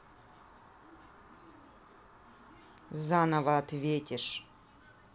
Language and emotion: Russian, angry